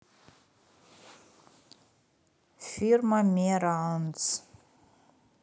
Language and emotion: Russian, neutral